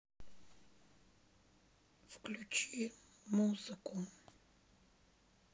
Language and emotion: Russian, sad